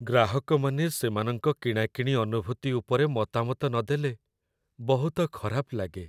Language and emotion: Odia, sad